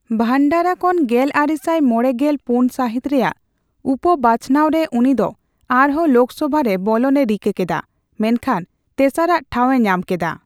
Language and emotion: Santali, neutral